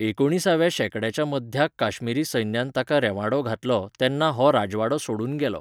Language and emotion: Goan Konkani, neutral